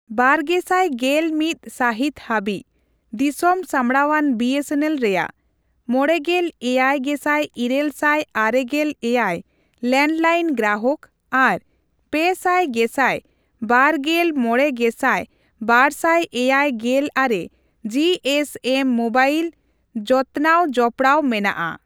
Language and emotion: Santali, neutral